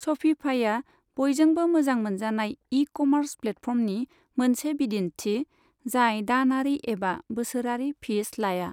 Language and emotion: Bodo, neutral